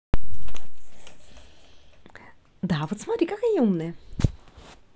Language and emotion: Russian, positive